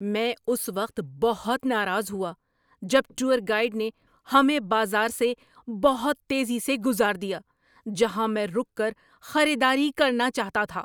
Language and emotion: Urdu, angry